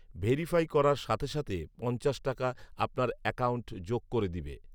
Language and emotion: Bengali, neutral